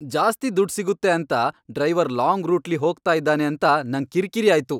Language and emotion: Kannada, angry